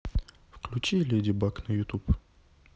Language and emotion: Russian, neutral